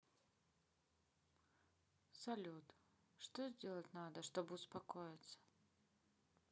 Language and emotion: Russian, sad